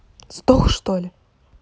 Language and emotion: Russian, angry